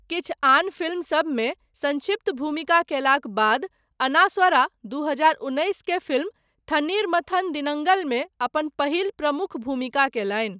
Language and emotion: Maithili, neutral